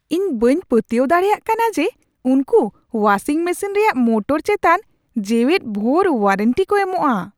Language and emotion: Santali, surprised